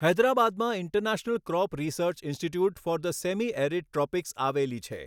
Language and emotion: Gujarati, neutral